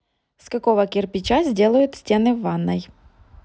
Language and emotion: Russian, neutral